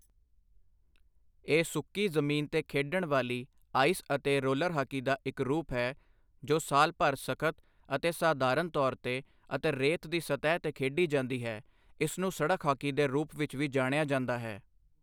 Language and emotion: Punjabi, neutral